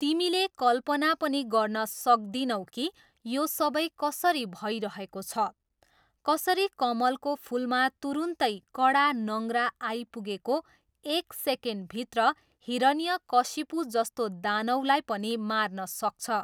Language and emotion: Nepali, neutral